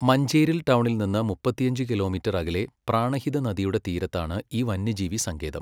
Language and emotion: Malayalam, neutral